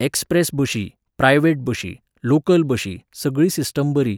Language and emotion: Goan Konkani, neutral